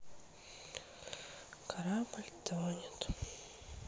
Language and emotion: Russian, sad